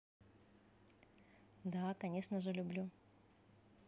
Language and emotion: Russian, positive